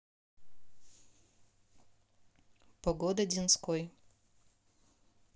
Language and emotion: Russian, neutral